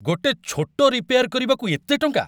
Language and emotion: Odia, angry